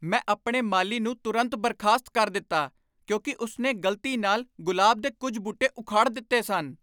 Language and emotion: Punjabi, angry